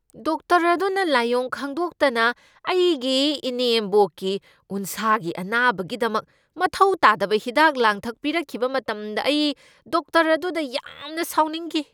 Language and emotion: Manipuri, angry